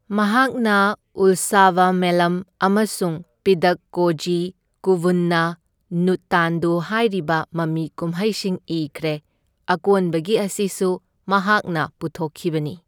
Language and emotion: Manipuri, neutral